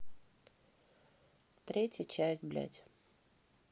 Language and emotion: Russian, neutral